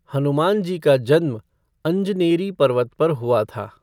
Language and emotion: Hindi, neutral